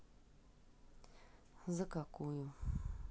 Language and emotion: Russian, sad